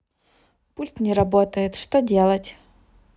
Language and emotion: Russian, neutral